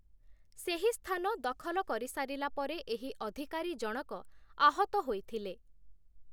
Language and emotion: Odia, neutral